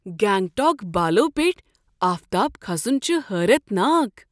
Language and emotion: Kashmiri, surprised